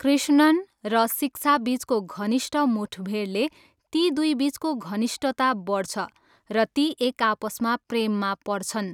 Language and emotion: Nepali, neutral